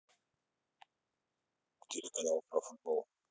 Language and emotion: Russian, neutral